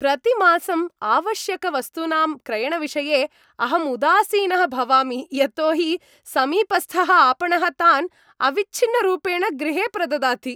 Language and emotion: Sanskrit, happy